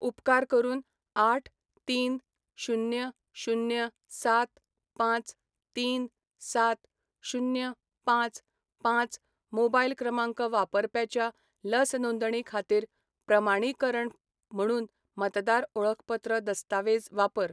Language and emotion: Goan Konkani, neutral